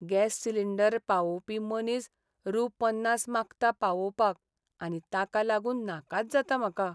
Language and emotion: Goan Konkani, sad